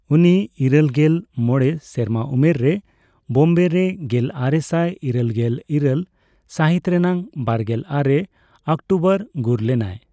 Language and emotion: Santali, neutral